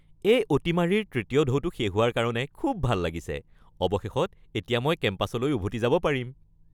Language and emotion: Assamese, happy